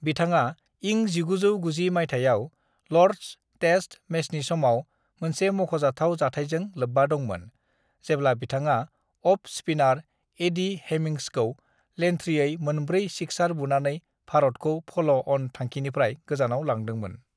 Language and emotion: Bodo, neutral